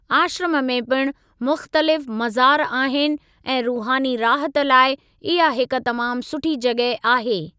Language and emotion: Sindhi, neutral